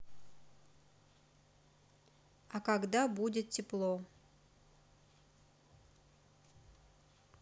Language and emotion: Russian, neutral